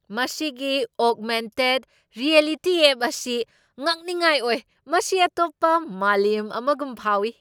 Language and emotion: Manipuri, surprised